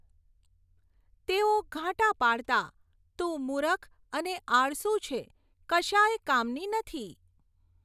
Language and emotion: Gujarati, neutral